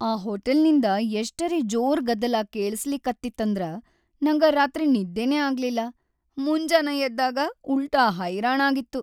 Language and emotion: Kannada, sad